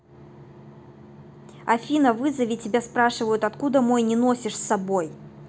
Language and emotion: Russian, angry